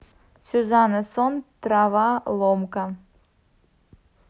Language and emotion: Russian, neutral